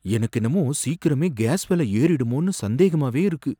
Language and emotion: Tamil, fearful